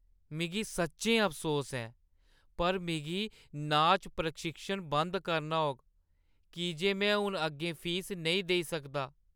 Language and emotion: Dogri, sad